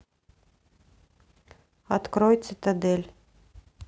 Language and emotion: Russian, neutral